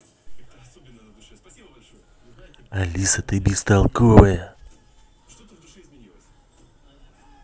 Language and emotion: Russian, angry